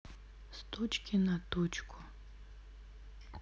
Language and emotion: Russian, sad